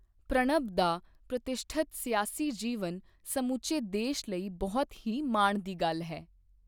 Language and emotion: Punjabi, neutral